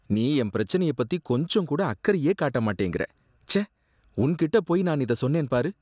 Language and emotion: Tamil, disgusted